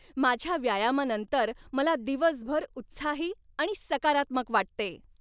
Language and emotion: Marathi, happy